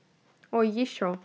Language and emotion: Russian, neutral